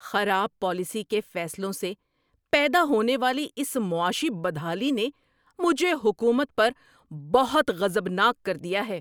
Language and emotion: Urdu, angry